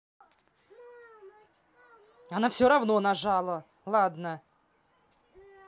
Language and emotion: Russian, angry